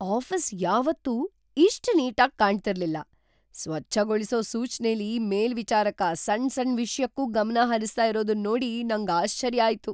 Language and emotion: Kannada, surprised